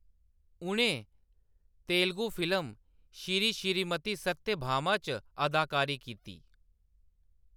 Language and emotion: Dogri, neutral